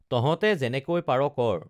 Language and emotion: Assamese, neutral